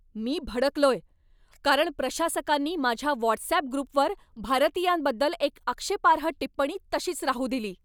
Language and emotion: Marathi, angry